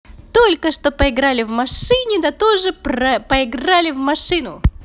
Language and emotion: Russian, positive